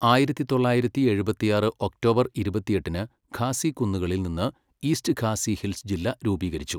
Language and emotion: Malayalam, neutral